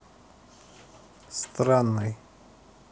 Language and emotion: Russian, neutral